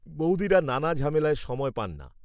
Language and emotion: Bengali, neutral